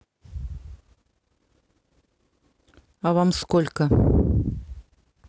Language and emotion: Russian, neutral